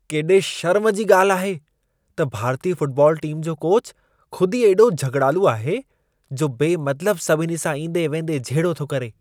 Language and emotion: Sindhi, disgusted